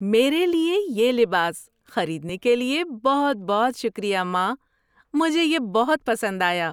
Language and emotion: Urdu, happy